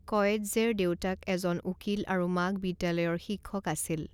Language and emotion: Assamese, neutral